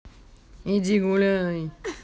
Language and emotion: Russian, angry